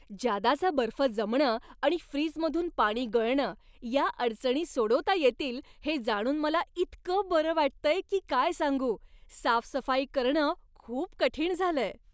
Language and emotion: Marathi, happy